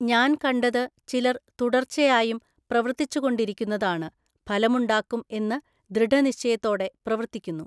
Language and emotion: Malayalam, neutral